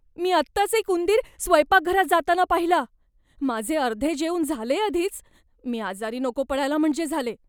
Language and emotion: Marathi, fearful